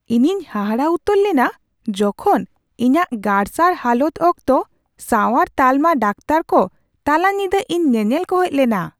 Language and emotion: Santali, surprised